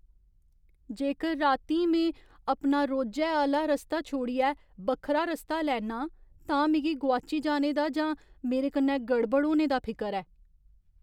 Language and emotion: Dogri, fearful